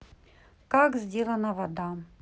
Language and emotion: Russian, neutral